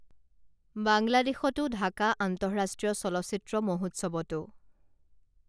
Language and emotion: Assamese, neutral